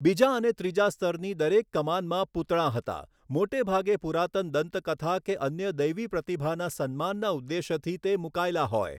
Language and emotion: Gujarati, neutral